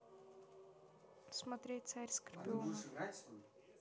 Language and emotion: Russian, neutral